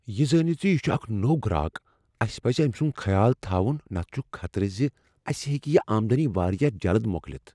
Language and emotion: Kashmiri, fearful